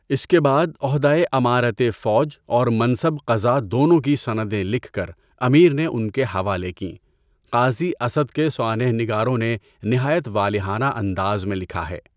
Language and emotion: Urdu, neutral